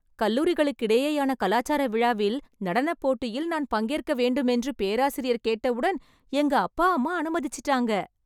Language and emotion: Tamil, happy